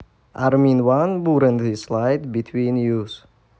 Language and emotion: Russian, neutral